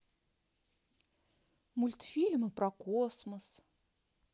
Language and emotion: Russian, neutral